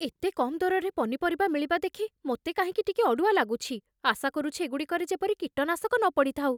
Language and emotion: Odia, fearful